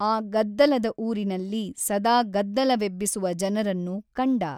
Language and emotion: Kannada, neutral